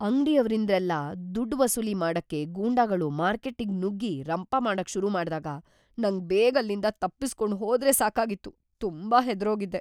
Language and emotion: Kannada, fearful